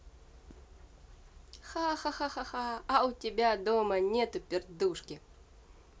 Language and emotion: Russian, positive